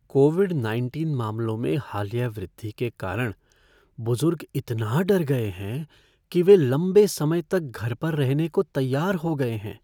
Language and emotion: Hindi, fearful